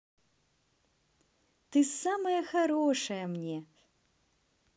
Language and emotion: Russian, positive